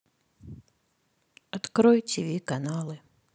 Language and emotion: Russian, sad